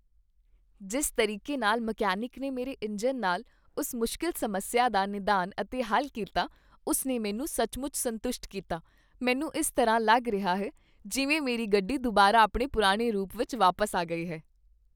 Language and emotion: Punjabi, happy